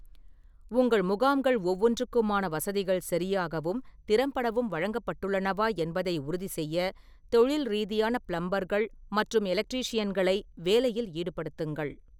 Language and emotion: Tamil, neutral